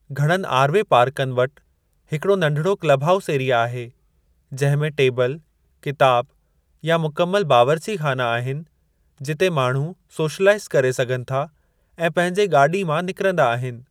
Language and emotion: Sindhi, neutral